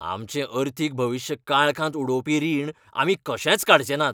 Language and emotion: Goan Konkani, angry